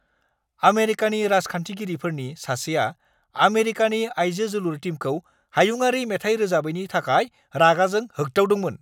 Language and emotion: Bodo, angry